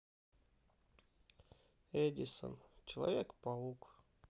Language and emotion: Russian, sad